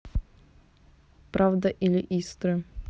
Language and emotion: Russian, neutral